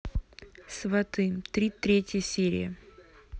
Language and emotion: Russian, neutral